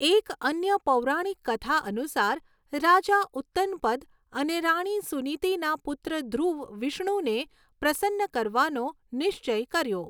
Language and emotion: Gujarati, neutral